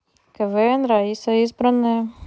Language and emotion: Russian, neutral